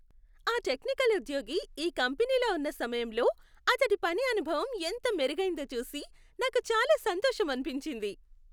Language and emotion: Telugu, happy